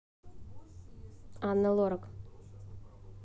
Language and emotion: Russian, neutral